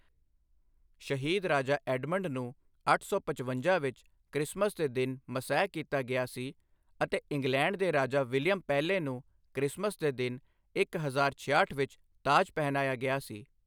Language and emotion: Punjabi, neutral